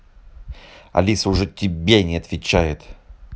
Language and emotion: Russian, angry